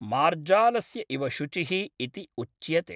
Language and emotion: Sanskrit, neutral